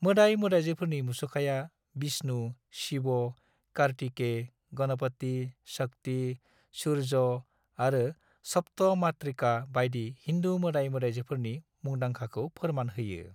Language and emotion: Bodo, neutral